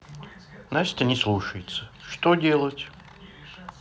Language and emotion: Russian, sad